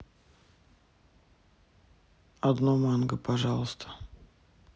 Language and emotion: Russian, neutral